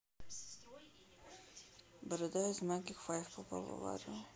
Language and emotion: Russian, neutral